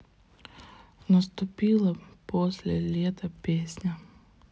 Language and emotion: Russian, sad